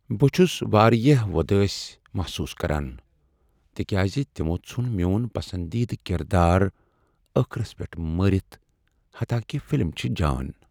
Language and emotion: Kashmiri, sad